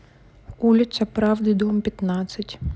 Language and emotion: Russian, neutral